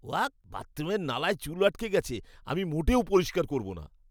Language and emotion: Bengali, disgusted